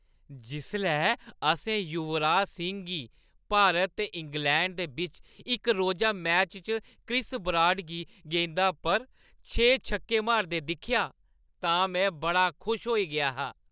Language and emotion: Dogri, happy